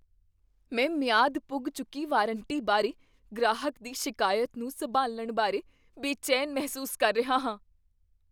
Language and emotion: Punjabi, fearful